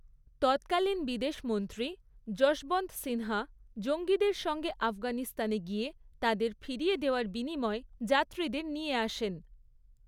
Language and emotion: Bengali, neutral